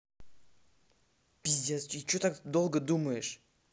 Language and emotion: Russian, angry